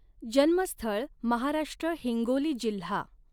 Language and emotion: Marathi, neutral